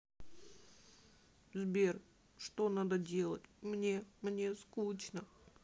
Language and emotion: Russian, sad